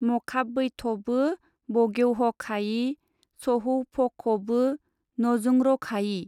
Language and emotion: Bodo, neutral